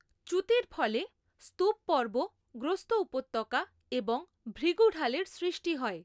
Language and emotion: Bengali, neutral